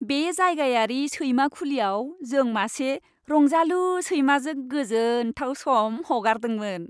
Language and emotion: Bodo, happy